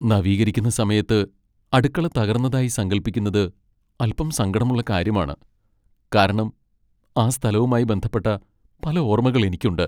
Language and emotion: Malayalam, sad